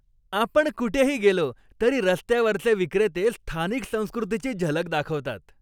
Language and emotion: Marathi, happy